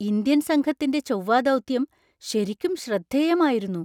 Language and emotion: Malayalam, surprised